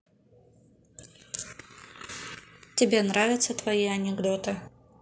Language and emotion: Russian, neutral